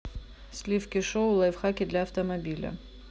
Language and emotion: Russian, neutral